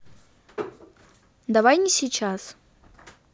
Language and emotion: Russian, neutral